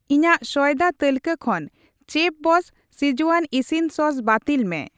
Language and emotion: Santali, neutral